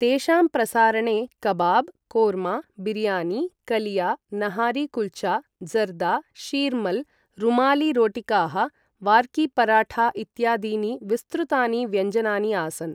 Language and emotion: Sanskrit, neutral